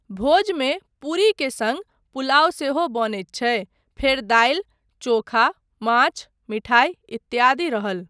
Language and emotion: Maithili, neutral